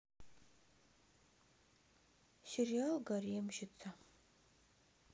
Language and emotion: Russian, sad